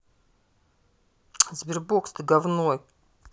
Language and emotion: Russian, angry